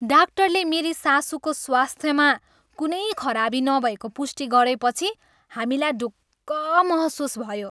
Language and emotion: Nepali, happy